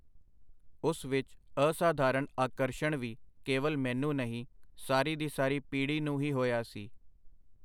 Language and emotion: Punjabi, neutral